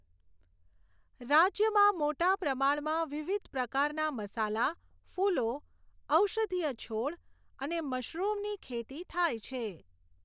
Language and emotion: Gujarati, neutral